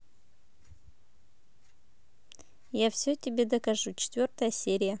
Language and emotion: Russian, neutral